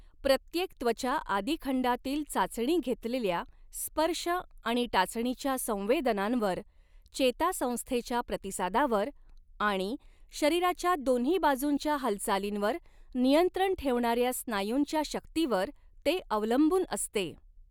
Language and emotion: Marathi, neutral